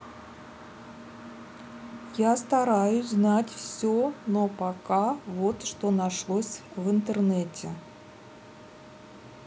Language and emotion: Russian, neutral